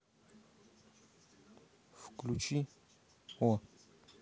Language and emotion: Russian, neutral